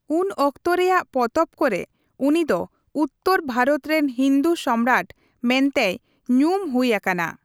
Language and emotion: Santali, neutral